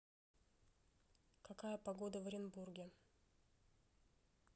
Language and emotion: Russian, neutral